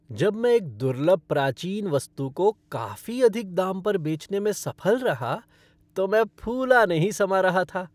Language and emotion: Hindi, happy